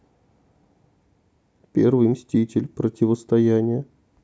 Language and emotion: Russian, sad